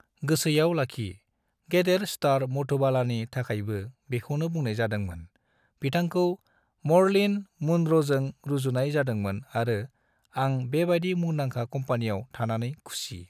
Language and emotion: Bodo, neutral